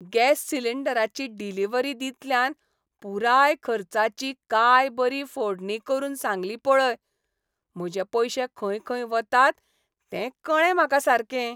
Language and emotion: Goan Konkani, happy